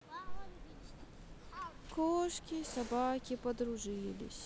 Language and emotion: Russian, sad